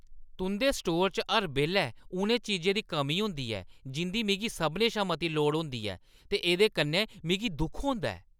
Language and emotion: Dogri, angry